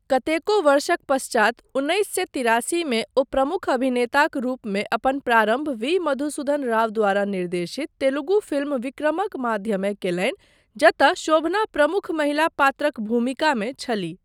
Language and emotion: Maithili, neutral